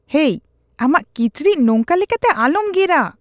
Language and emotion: Santali, disgusted